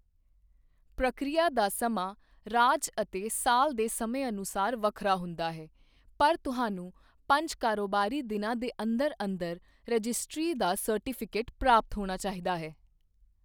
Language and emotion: Punjabi, neutral